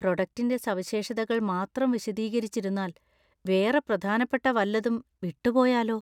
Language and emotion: Malayalam, fearful